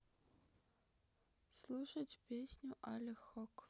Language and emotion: Russian, neutral